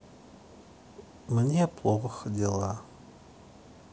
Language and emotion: Russian, sad